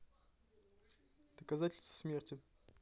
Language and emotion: Russian, neutral